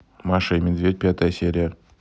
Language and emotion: Russian, neutral